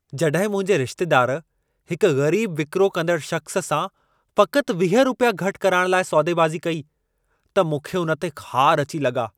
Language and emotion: Sindhi, angry